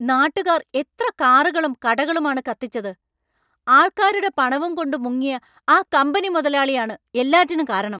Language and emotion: Malayalam, angry